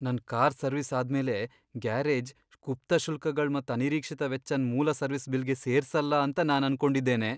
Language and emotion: Kannada, fearful